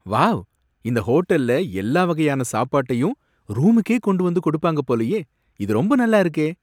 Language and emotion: Tamil, surprised